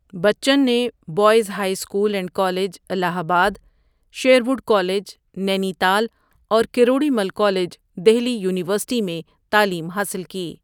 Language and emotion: Urdu, neutral